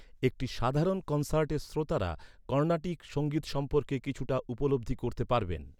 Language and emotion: Bengali, neutral